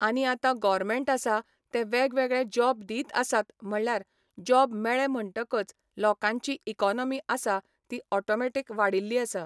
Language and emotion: Goan Konkani, neutral